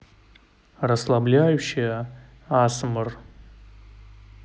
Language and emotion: Russian, neutral